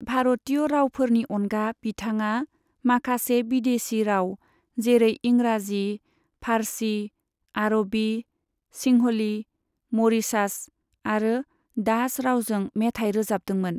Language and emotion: Bodo, neutral